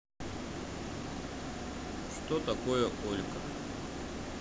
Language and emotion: Russian, neutral